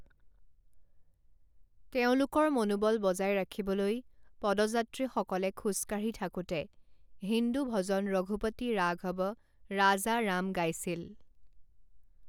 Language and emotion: Assamese, neutral